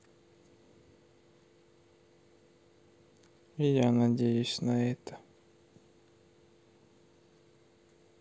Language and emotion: Russian, sad